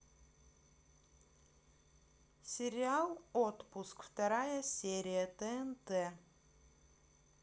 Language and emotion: Russian, neutral